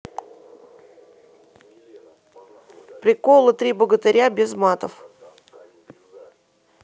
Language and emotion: Russian, neutral